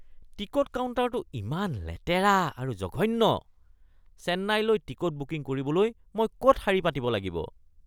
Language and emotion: Assamese, disgusted